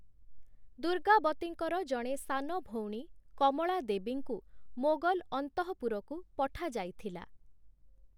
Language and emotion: Odia, neutral